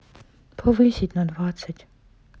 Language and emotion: Russian, sad